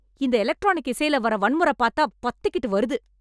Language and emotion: Tamil, angry